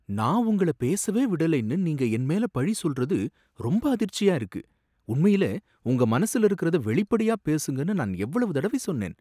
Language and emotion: Tamil, surprised